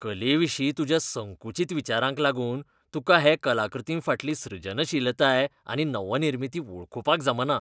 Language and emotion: Goan Konkani, disgusted